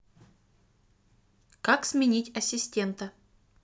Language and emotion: Russian, neutral